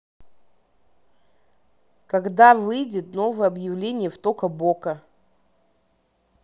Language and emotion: Russian, neutral